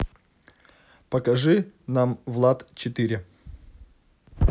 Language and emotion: Russian, neutral